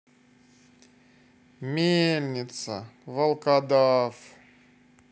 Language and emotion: Russian, sad